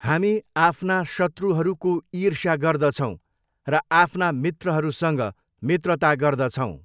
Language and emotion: Nepali, neutral